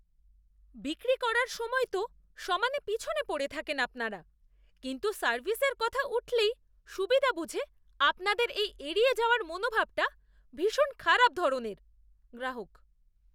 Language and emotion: Bengali, disgusted